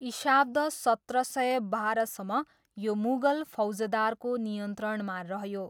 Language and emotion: Nepali, neutral